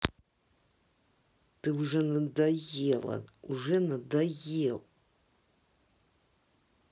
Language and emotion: Russian, angry